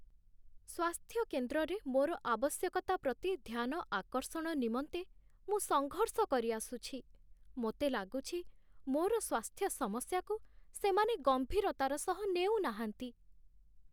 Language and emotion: Odia, sad